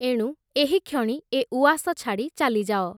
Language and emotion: Odia, neutral